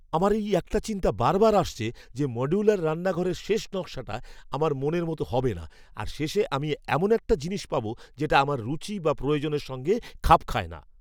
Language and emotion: Bengali, fearful